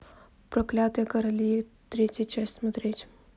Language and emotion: Russian, neutral